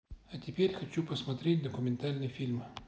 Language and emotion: Russian, neutral